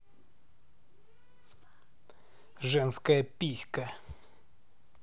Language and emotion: Russian, angry